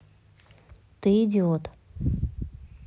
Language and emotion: Russian, neutral